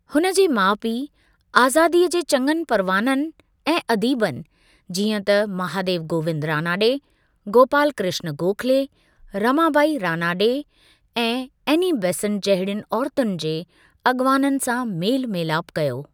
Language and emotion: Sindhi, neutral